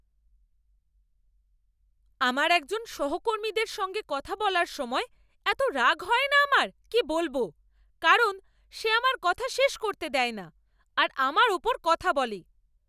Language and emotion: Bengali, angry